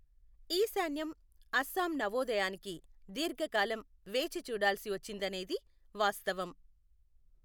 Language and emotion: Telugu, neutral